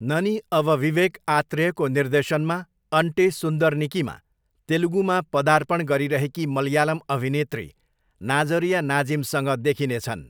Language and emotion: Nepali, neutral